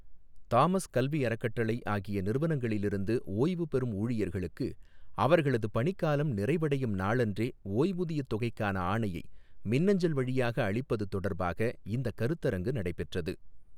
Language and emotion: Tamil, neutral